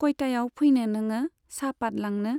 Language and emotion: Bodo, neutral